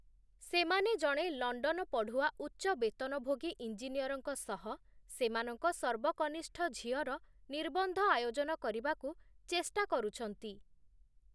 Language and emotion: Odia, neutral